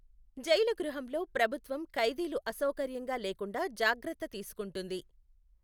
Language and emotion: Telugu, neutral